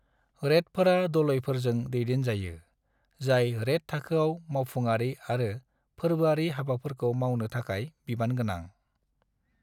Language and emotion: Bodo, neutral